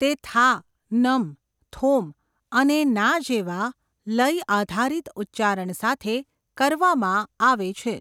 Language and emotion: Gujarati, neutral